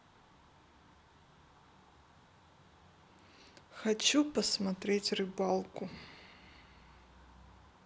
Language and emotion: Russian, neutral